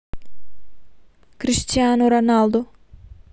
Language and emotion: Russian, neutral